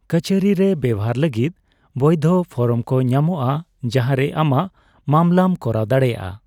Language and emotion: Santali, neutral